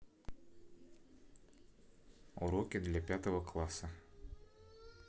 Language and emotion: Russian, neutral